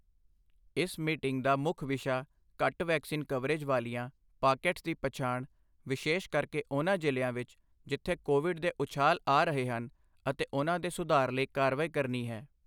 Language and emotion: Punjabi, neutral